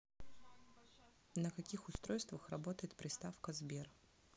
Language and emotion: Russian, neutral